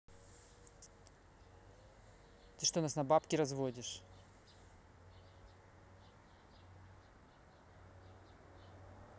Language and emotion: Russian, angry